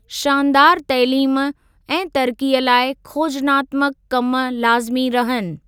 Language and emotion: Sindhi, neutral